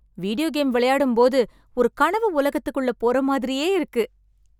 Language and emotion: Tamil, happy